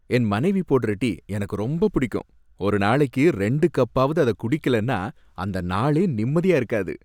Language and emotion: Tamil, happy